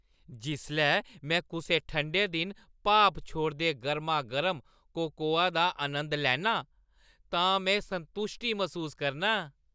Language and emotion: Dogri, happy